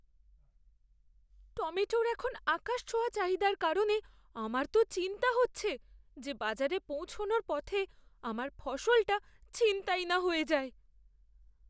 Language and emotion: Bengali, fearful